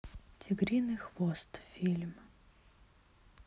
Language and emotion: Russian, sad